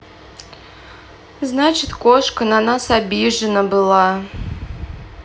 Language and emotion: Russian, sad